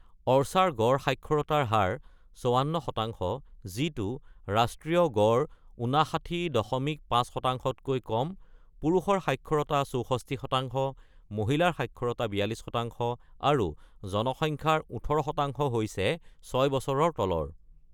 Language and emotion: Assamese, neutral